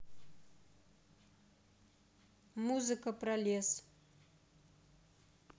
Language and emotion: Russian, neutral